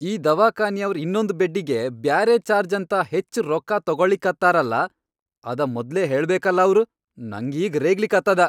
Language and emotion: Kannada, angry